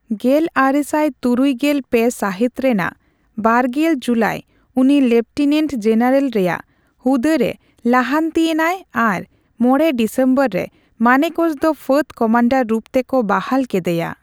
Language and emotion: Santali, neutral